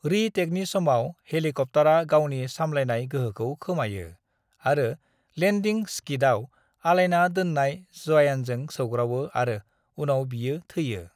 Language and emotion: Bodo, neutral